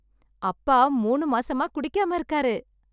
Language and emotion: Tamil, happy